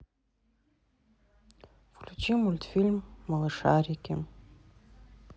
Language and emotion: Russian, neutral